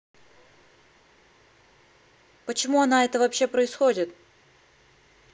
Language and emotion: Russian, neutral